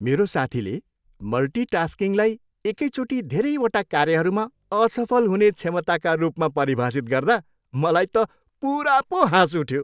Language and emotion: Nepali, happy